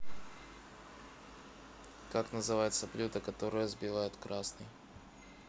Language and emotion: Russian, neutral